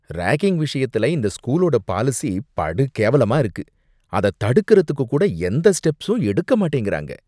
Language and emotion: Tamil, disgusted